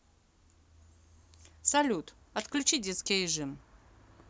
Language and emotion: Russian, neutral